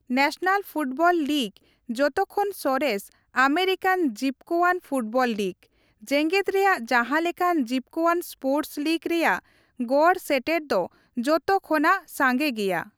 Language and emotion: Santali, neutral